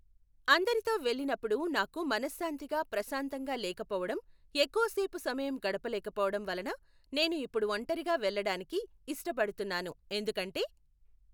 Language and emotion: Telugu, neutral